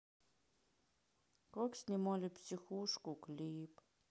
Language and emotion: Russian, sad